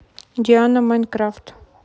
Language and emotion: Russian, neutral